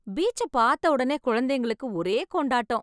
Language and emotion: Tamil, happy